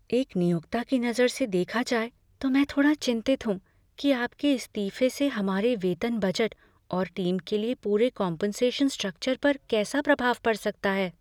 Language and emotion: Hindi, fearful